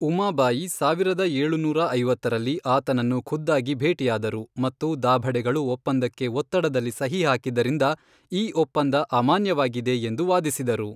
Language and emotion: Kannada, neutral